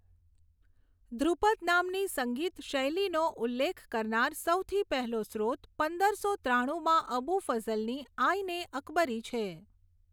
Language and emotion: Gujarati, neutral